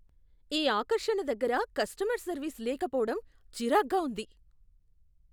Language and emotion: Telugu, disgusted